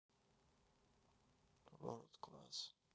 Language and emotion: Russian, sad